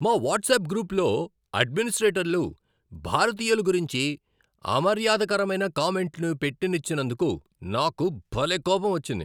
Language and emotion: Telugu, angry